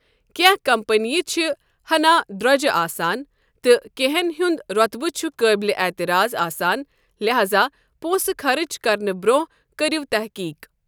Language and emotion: Kashmiri, neutral